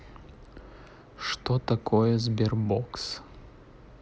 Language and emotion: Russian, neutral